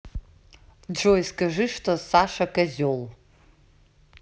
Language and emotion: Russian, neutral